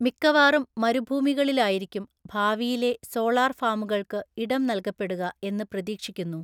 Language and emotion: Malayalam, neutral